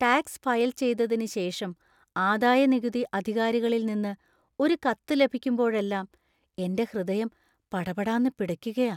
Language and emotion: Malayalam, fearful